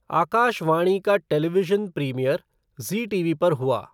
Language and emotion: Hindi, neutral